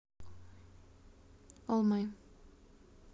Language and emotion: Russian, neutral